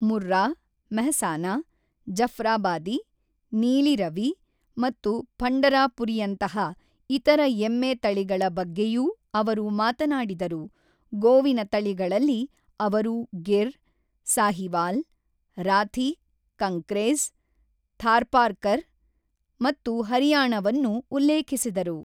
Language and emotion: Kannada, neutral